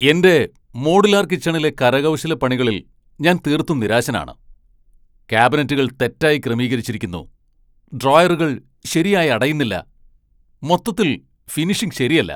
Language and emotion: Malayalam, angry